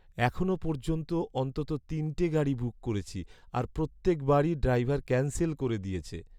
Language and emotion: Bengali, sad